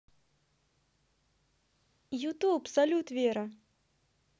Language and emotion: Russian, positive